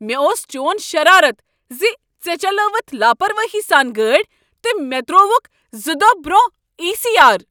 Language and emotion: Kashmiri, angry